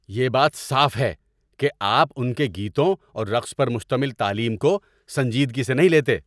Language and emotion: Urdu, angry